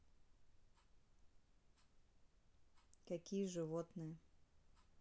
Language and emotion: Russian, neutral